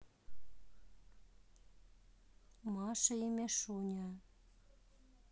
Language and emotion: Russian, neutral